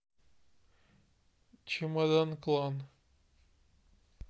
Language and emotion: Russian, neutral